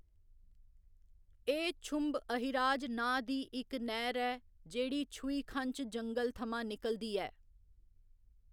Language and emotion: Dogri, neutral